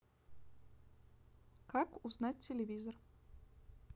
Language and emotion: Russian, neutral